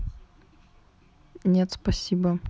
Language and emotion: Russian, neutral